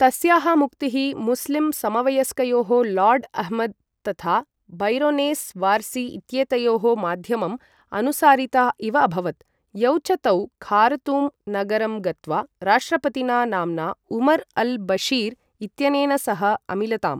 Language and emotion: Sanskrit, neutral